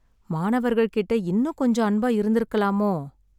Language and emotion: Tamil, sad